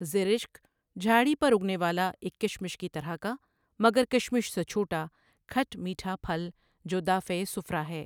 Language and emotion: Urdu, neutral